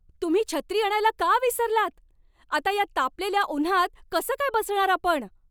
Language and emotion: Marathi, angry